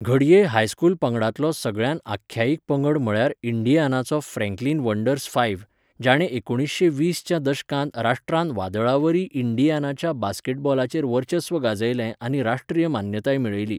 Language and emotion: Goan Konkani, neutral